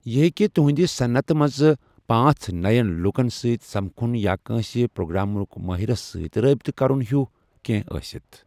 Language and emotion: Kashmiri, neutral